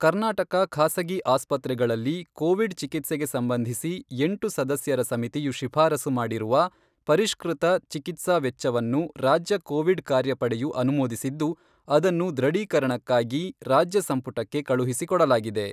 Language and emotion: Kannada, neutral